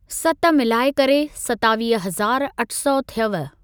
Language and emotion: Sindhi, neutral